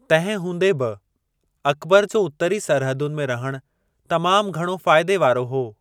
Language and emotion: Sindhi, neutral